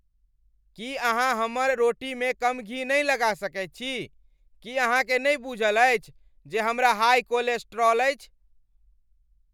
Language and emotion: Maithili, angry